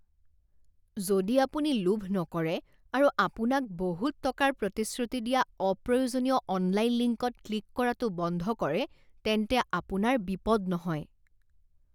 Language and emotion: Assamese, disgusted